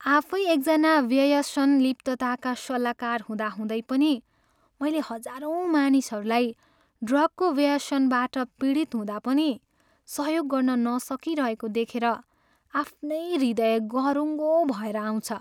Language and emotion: Nepali, sad